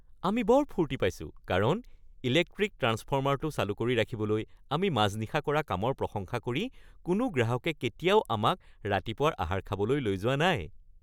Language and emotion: Assamese, happy